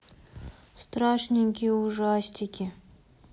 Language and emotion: Russian, sad